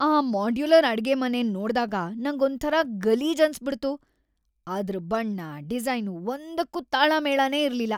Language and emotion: Kannada, disgusted